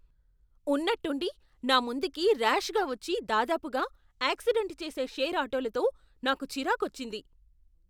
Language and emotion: Telugu, angry